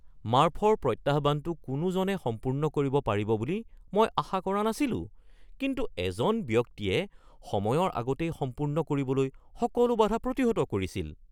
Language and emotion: Assamese, surprised